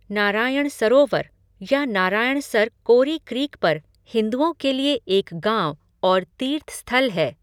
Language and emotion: Hindi, neutral